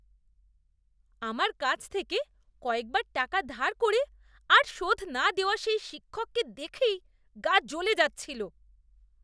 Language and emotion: Bengali, disgusted